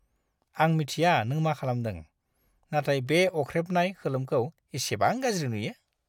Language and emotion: Bodo, disgusted